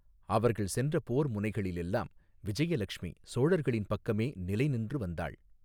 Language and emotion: Tamil, neutral